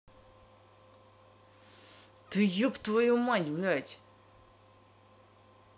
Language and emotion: Russian, angry